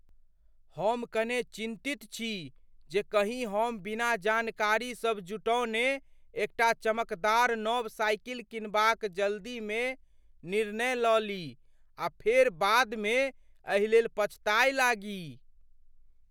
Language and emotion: Maithili, fearful